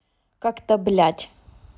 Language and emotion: Russian, angry